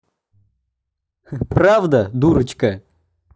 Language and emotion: Russian, positive